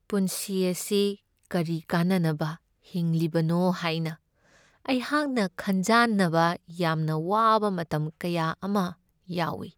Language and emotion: Manipuri, sad